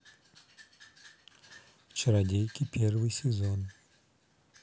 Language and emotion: Russian, neutral